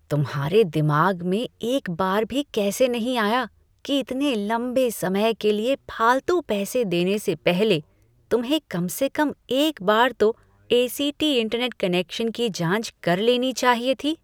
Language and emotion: Hindi, disgusted